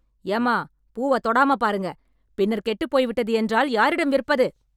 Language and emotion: Tamil, angry